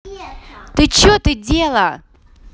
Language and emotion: Russian, angry